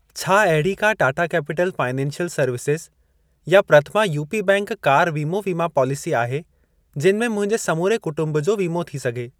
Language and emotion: Sindhi, neutral